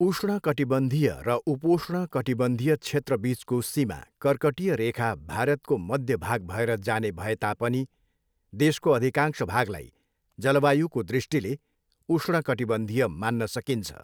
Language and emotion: Nepali, neutral